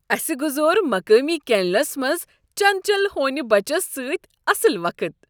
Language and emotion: Kashmiri, happy